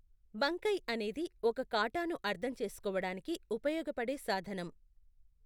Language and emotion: Telugu, neutral